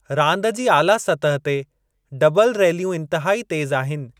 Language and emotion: Sindhi, neutral